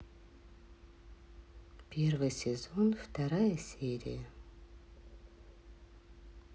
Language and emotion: Russian, sad